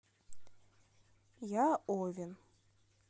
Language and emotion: Russian, neutral